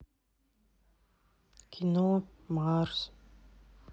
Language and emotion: Russian, sad